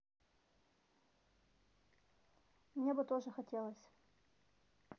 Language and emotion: Russian, neutral